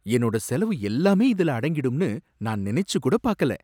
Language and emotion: Tamil, surprised